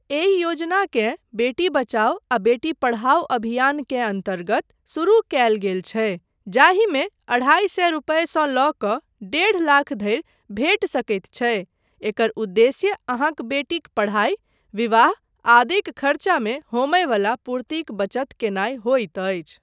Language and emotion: Maithili, neutral